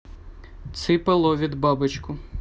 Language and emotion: Russian, neutral